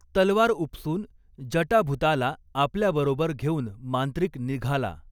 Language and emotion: Marathi, neutral